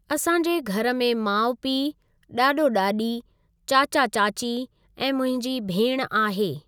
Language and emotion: Sindhi, neutral